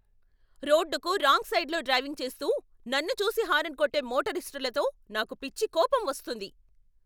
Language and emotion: Telugu, angry